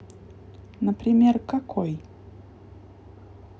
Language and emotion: Russian, neutral